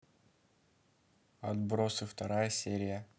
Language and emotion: Russian, neutral